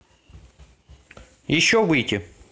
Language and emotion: Russian, neutral